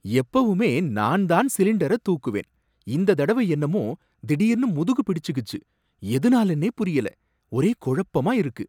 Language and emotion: Tamil, surprised